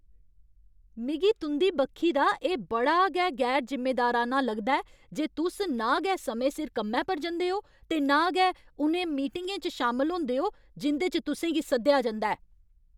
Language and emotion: Dogri, angry